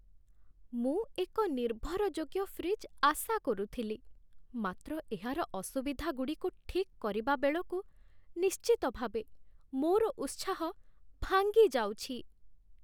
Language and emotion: Odia, sad